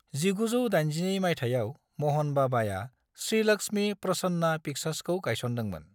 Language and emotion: Bodo, neutral